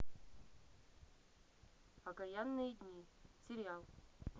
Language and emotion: Russian, neutral